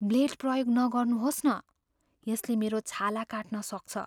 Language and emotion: Nepali, fearful